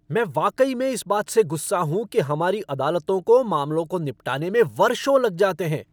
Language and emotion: Hindi, angry